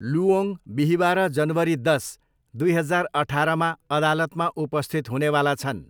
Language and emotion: Nepali, neutral